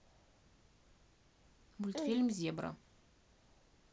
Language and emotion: Russian, neutral